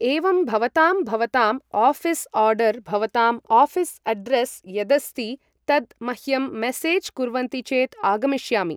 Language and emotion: Sanskrit, neutral